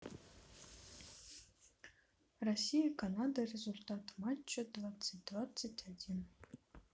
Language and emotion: Russian, neutral